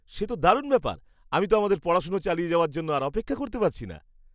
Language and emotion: Bengali, happy